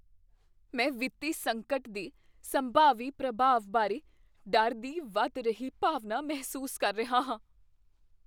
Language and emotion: Punjabi, fearful